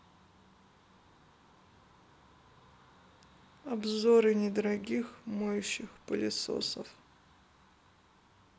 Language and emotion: Russian, neutral